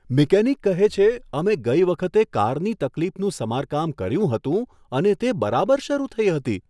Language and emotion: Gujarati, surprised